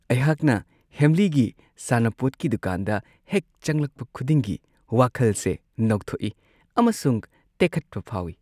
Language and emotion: Manipuri, happy